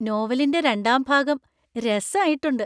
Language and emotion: Malayalam, happy